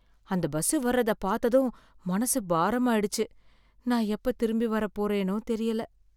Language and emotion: Tamil, sad